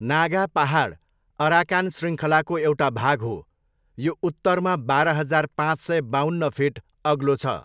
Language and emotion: Nepali, neutral